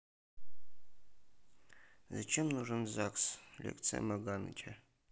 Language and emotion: Russian, neutral